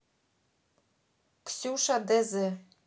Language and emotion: Russian, neutral